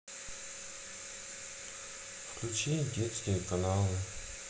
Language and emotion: Russian, sad